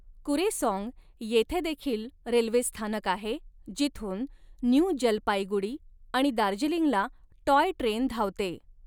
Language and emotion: Marathi, neutral